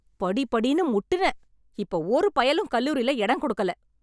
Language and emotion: Tamil, angry